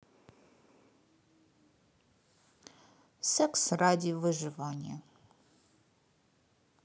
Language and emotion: Russian, neutral